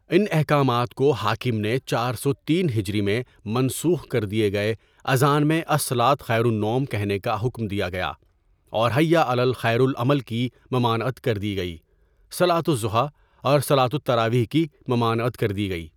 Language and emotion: Urdu, neutral